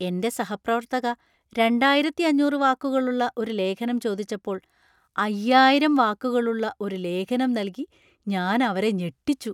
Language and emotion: Malayalam, surprised